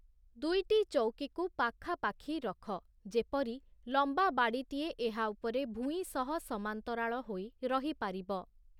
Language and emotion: Odia, neutral